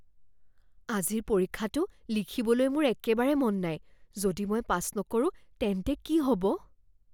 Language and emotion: Assamese, fearful